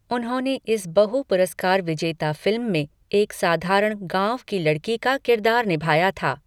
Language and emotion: Hindi, neutral